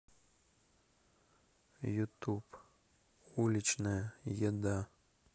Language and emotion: Russian, sad